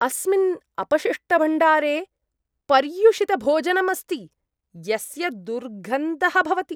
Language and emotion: Sanskrit, disgusted